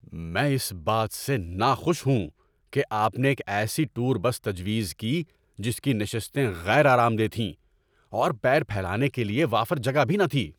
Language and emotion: Urdu, angry